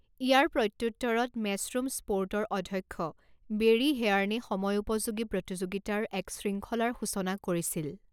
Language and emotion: Assamese, neutral